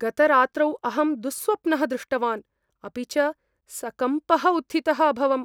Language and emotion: Sanskrit, fearful